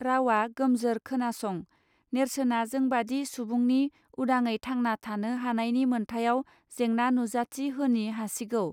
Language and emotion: Bodo, neutral